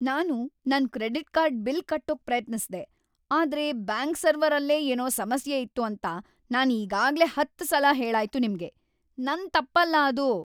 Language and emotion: Kannada, angry